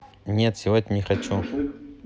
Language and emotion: Russian, neutral